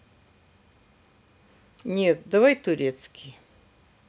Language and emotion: Russian, neutral